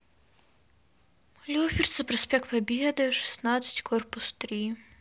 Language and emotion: Russian, sad